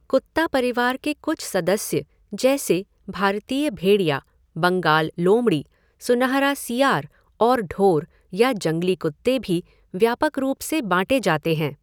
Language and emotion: Hindi, neutral